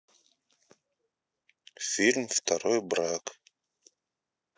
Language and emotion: Russian, neutral